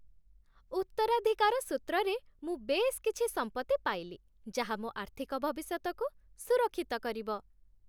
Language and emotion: Odia, happy